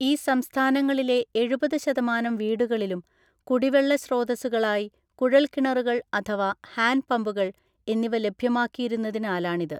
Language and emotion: Malayalam, neutral